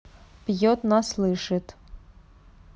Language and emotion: Russian, neutral